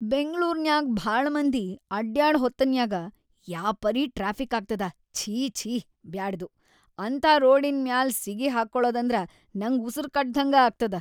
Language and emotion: Kannada, disgusted